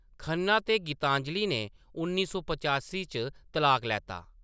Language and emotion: Dogri, neutral